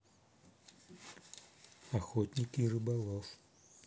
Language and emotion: Russian, neutral